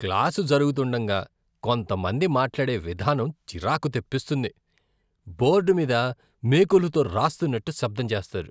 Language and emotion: Telugu, disgusted